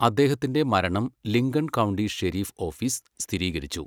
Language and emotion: Malayalam, neutral